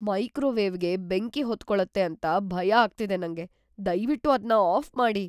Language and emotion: Kannada, fearful